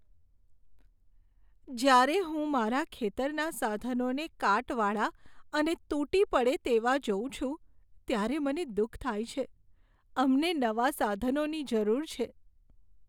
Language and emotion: Gujarati, sad